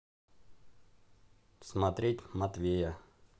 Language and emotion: Russian, neutral